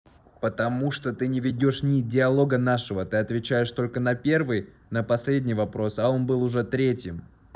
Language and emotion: Russian, angry